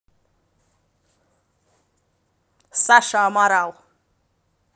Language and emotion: Russian, neutral